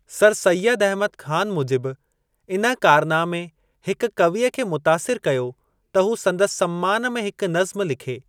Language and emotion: Sindhi, neutral